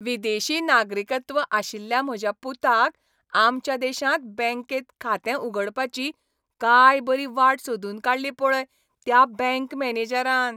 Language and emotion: Goan Konkani, happy